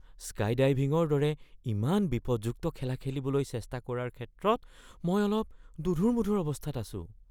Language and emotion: Assamese, fearful